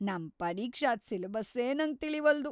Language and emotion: Kannada, fearful